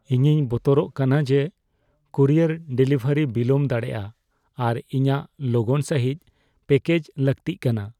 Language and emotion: Santali, fearful